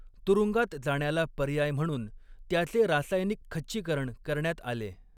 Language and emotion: Marathi, neutral